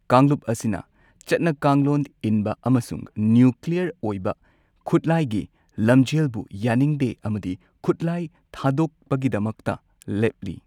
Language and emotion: Manipuri, neutral